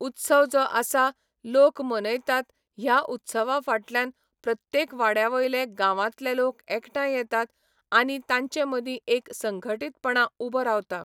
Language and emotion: Goan Konkani, neutral